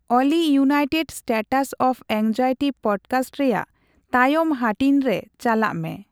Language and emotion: Santali, neutral